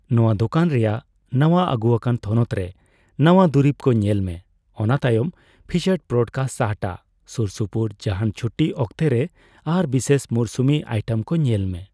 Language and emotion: Santali, neutral